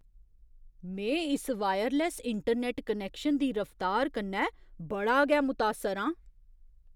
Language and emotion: Dogri, surprised